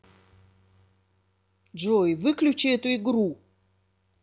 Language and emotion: Russian, angry